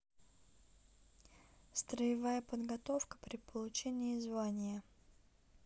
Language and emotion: Russian, neutral